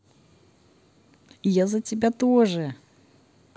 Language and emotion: Russian, positive